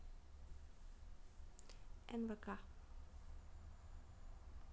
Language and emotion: Russian, neutral